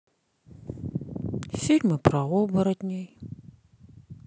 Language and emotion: Russian, sad